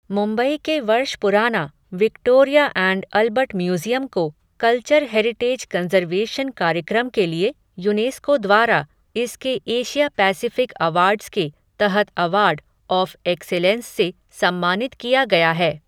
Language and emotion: Hindi, neutral